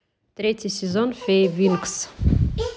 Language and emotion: Russian, neutral